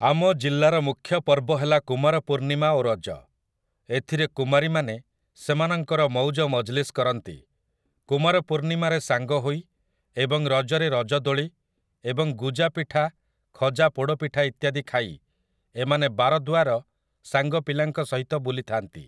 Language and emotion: Odia, neutral